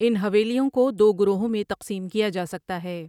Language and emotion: Urdu, neutral